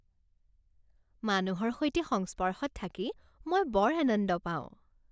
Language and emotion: Assamese, happy